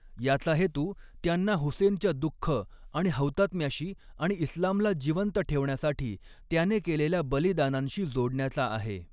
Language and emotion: Marathi, neutral